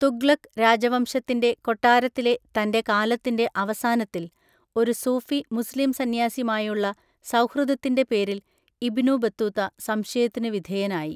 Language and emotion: Malayalam, neutral